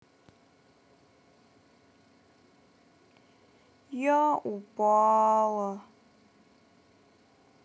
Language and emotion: Russian, sad